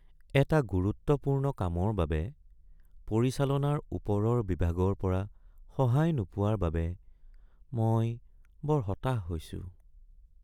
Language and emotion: Assamese, sad